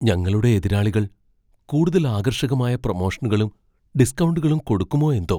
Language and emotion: Malayalam, fearful